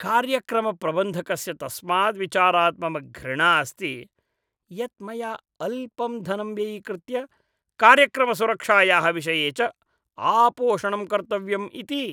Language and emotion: Sanskrit, disgusted